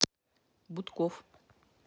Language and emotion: Russian, neutral